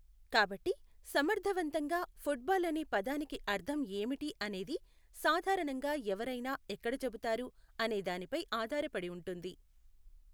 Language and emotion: Telugu, neutral